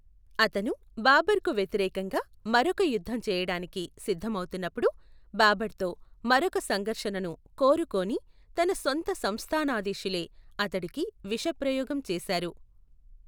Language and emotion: Telugu, neutral